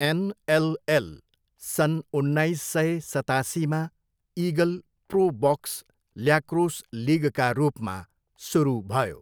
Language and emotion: Nepali, neutral